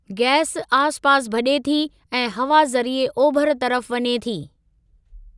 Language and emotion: Sindhi, neutral